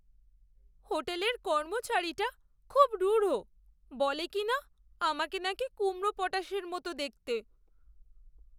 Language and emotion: Bengali, sad